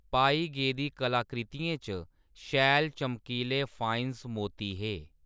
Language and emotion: Dogri, neutral